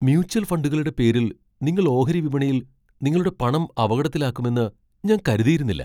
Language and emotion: Malayalam, surprised